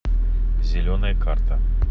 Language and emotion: Russian, neutral